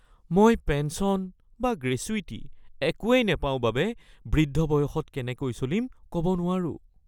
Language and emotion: Assamese, fearful